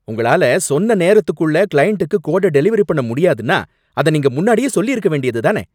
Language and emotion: Tamil, angry